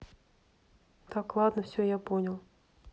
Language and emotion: Russian, neutral